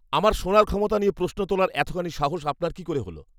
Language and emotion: Bengali, angry